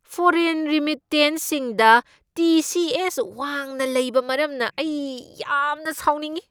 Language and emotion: Manipuri, angry